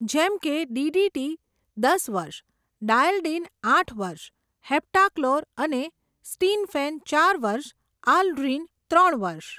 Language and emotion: Gujarati, neutral